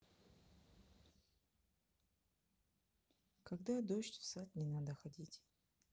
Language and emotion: Russian, neutral